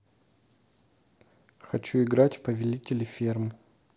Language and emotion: Russian, neutral